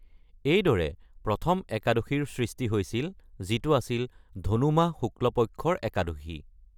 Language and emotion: Assamese, neutral